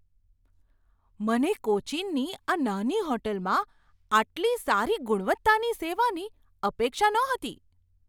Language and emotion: Gujarati, surprised